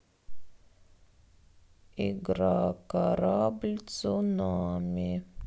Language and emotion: Russian, sad